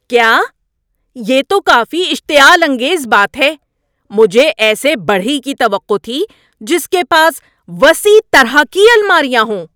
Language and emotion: Urdu, angry